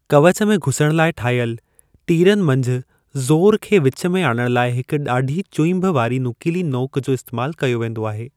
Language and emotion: Sindhi, neutral